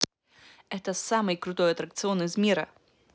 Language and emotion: Russian, positive